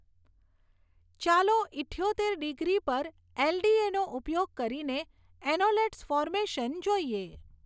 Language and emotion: Gujarati, neutral